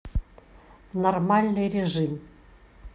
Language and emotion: Russian, neutral